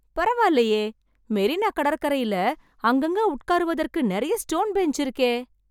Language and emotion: Tamil, happy